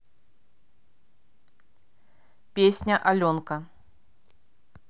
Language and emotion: Russian, neutral